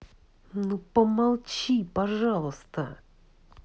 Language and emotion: Russian, angry